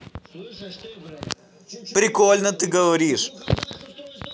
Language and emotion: Russian, positive